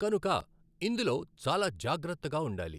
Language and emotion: Telugu, neutral